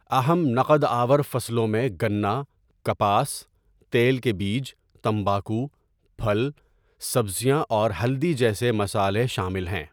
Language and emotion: Urdu, neutral